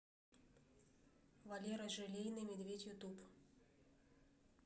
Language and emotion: Russian, neutral